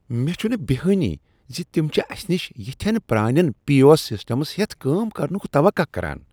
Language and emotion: Kashmiri, disgusted